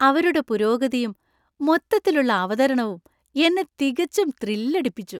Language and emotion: Malayalam, happy